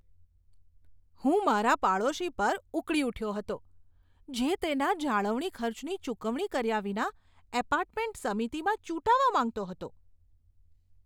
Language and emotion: Gujarati, disgusted